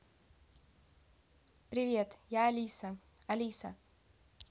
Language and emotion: Russian, neutral